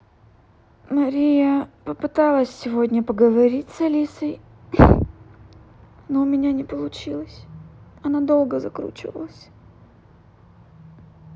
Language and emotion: Russian, sad